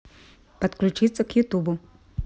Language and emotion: Russian, neutral